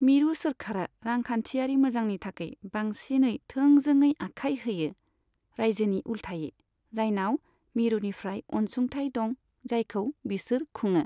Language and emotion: Bodo, neutral